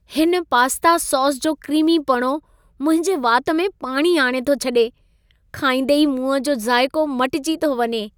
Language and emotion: Sindhi, happy